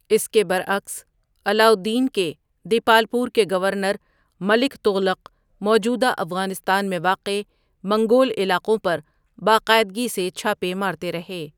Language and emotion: Urdu, neutral